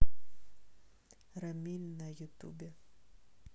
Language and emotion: Russian, neutral